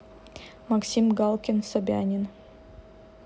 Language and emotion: Russian, neutral